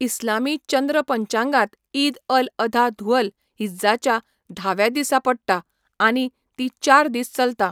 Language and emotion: Goan Konkani, neutral